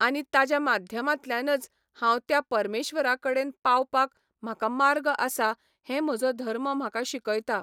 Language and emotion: Goan Konkani, neutral